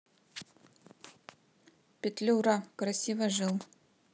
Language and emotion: Russian, neutral